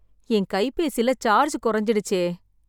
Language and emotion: Tamil, sad